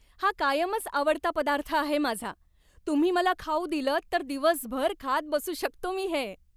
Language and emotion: Marathi, happy